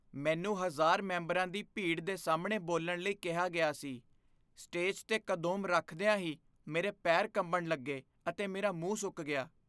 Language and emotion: Punjabi, fearful